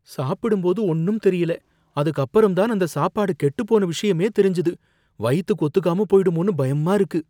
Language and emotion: Tamil, fearful